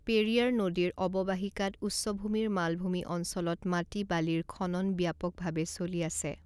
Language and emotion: Assamese, neutral